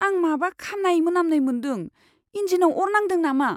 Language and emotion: Bodo, fearful